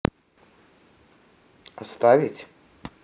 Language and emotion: Russian, neutral